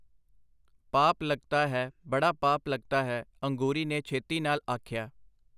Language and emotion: Punjabi, neutral